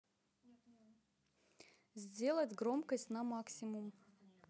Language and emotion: Russian, neutral